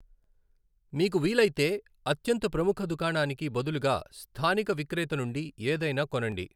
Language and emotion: Telugu, neutral